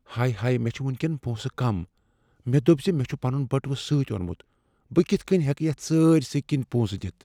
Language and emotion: Kashmiri, fearful